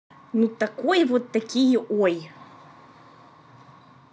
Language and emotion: Russian, angry